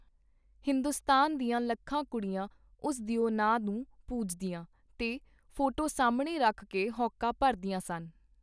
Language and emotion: Punjabi, neutral